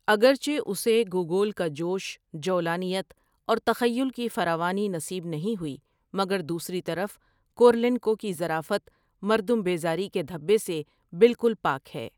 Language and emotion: Urdu, neutral